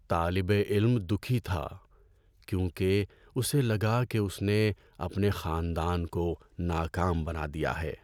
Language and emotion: Urdu, sad